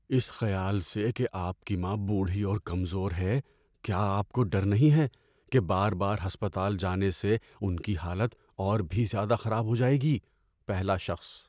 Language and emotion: Urdu, fearful